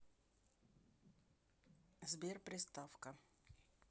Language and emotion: Russian, neutral